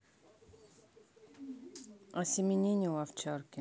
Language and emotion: Russian, neutral